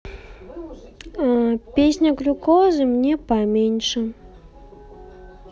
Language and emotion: Russian, sad